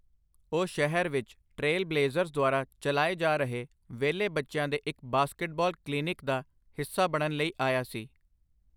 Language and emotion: Punjabi, neutral